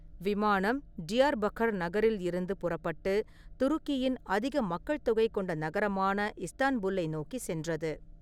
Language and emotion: Tamil, neutral